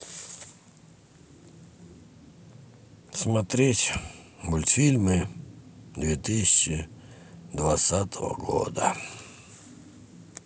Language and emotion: Russian, sad